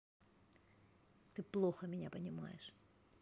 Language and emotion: Russian, angry